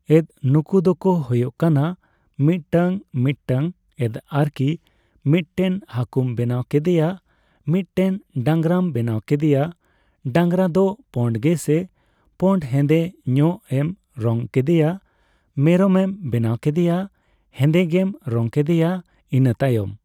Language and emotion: Santali, neutral